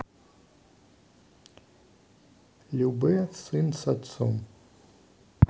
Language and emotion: Russian, neutral